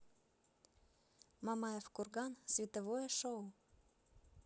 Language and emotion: Russian, neutral